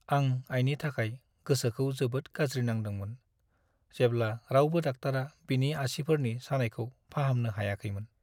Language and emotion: Bodo, sad